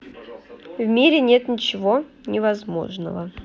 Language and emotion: Russian, neutral